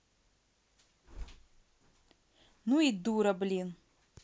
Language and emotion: Russian, angry